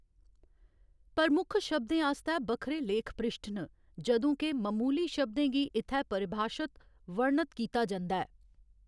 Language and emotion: Dogri, neutral